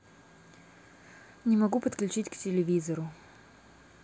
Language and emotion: Russian, neutral